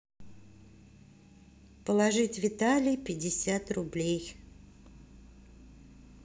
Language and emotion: Russian, neutral